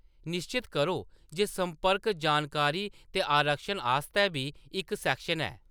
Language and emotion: Dogri, neutral